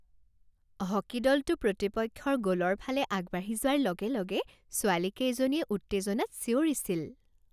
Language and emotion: Assamese, happy